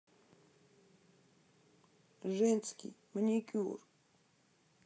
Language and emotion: Russian, sad